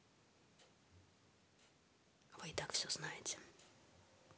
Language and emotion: Russian, neutral